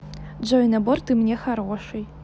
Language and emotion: Russian, positive